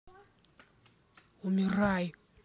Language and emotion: Russian, angry